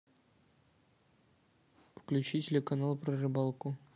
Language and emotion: Russian, neutral